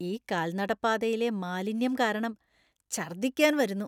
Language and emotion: Malayalam, disgusted